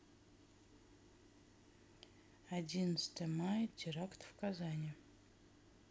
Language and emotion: Russian, neutral